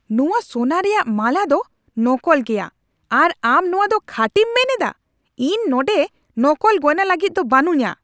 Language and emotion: Santali, angry